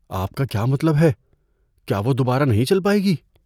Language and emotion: Urdu, fearful